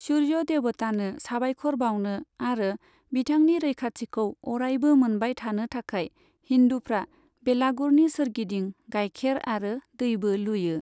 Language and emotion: Bodo, neutral